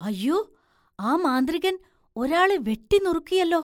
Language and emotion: Malayalam, surprised